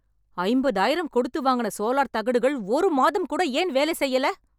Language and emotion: Tamil, angry